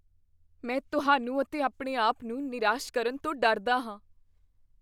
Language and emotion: Punjabi, fearful